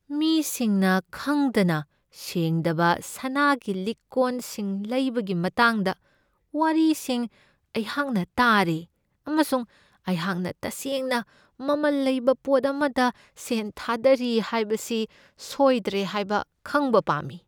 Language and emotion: Manipuri, fearful